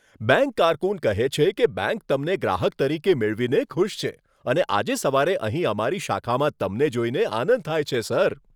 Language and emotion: Gujarati, happy